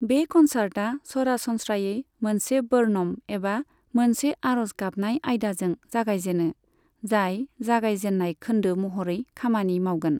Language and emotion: Bodo, neutral